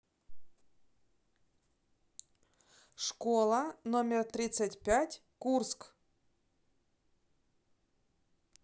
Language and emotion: Russian, neutral